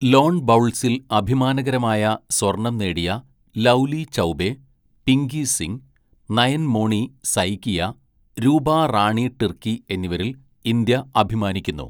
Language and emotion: Malayalam, neutral